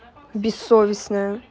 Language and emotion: Russian, angry